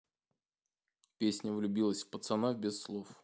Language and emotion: Russian, neutral